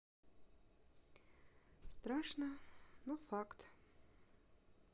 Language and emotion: Russian, sad